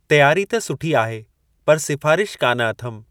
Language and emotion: Sindhi, neutral